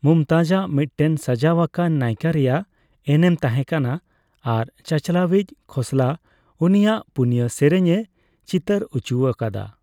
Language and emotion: Santali, neutral